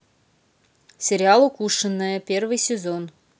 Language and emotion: Russian, neutral